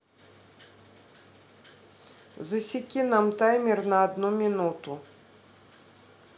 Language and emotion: Russian, neutral